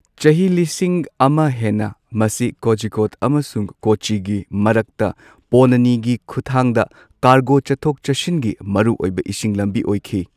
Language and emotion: Manipuri, neutral